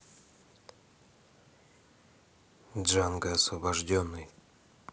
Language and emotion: Russian, neutral